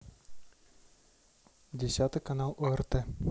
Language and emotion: Russian, neutral